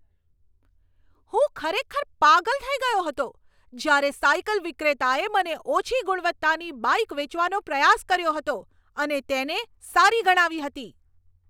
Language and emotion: Gujarati, angry